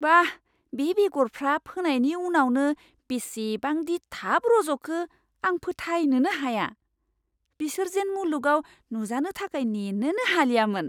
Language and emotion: Bodo, surprised